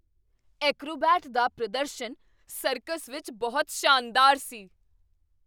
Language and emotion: Punjabi, surprised